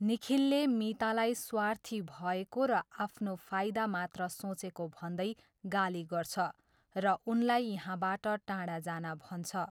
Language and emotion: Nepali, neutral